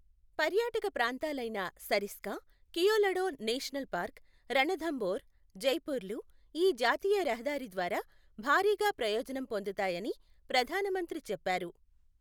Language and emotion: Telugu, neutral